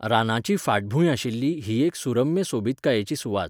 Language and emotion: Goan Konkani, neutral